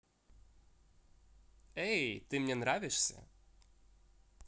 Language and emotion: Russian, positive